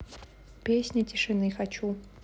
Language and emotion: Russian, neutral